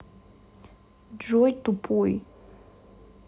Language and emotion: Russian, angry